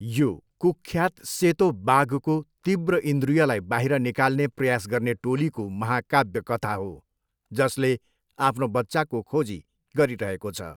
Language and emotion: Nepali, neutral